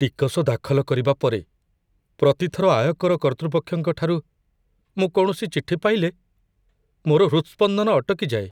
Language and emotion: Odia, fearful